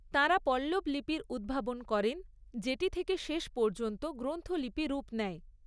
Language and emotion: Bengali, neutral